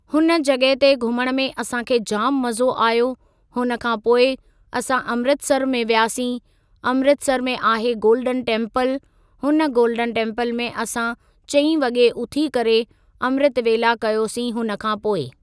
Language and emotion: Sindhi, neutral